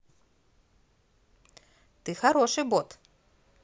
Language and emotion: Russian, positive